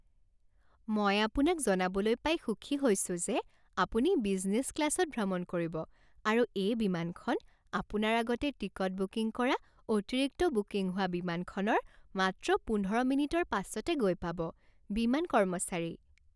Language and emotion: Assamese, happy